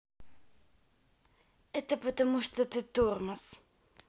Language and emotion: Russian, neutral